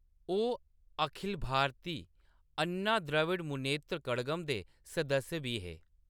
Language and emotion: Dogri, neutral